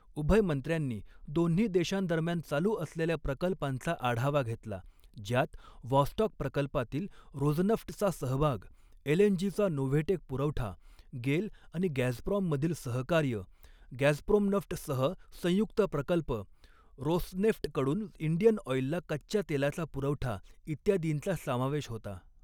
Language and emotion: Marathi, neutral